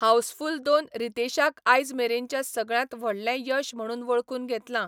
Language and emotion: Goan Konkani, neutral